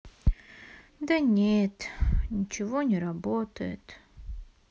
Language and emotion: Russian, sad